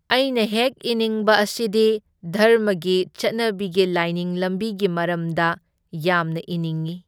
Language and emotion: Manipuri, neutral